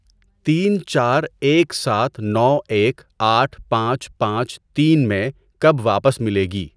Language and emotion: Urdu, neutral